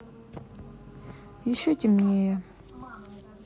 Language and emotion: Russian, sad